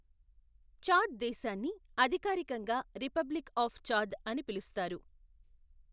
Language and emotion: Telugu, neutral